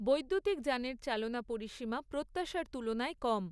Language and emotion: Bengali, neutral